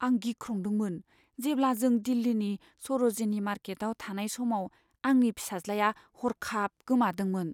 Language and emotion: Bodo, fearful